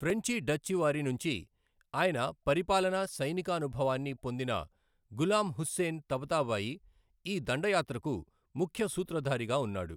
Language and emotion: Telugu, neutral